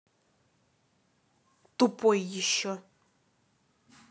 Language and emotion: Russian, angry